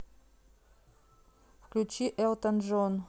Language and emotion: Russian, neutral